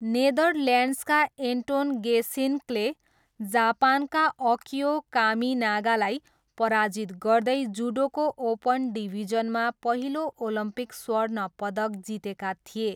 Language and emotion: Nepali, neutral